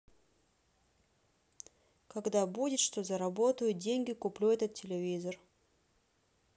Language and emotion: Russian, neutral